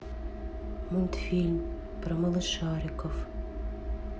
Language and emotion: Russian, sad